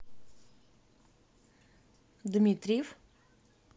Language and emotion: Russian, neutral